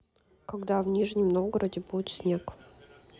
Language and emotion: Russian, neutral